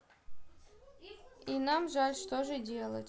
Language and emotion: Russian, neutral